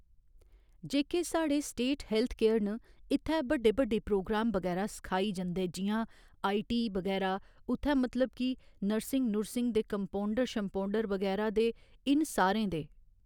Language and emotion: Dogri, neutral